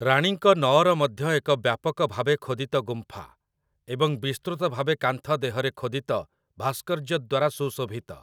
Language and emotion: Odia, neutral